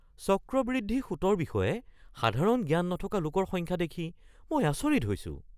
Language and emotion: Assamese, surprised